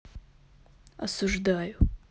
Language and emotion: Russian, neutral